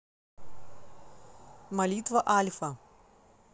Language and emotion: Russian, neutral